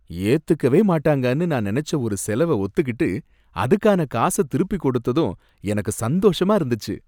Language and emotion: Tamil, happy